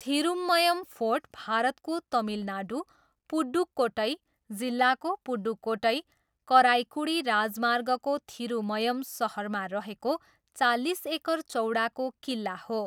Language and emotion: Nepali, neutral